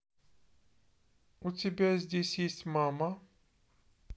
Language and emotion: Russian, neutral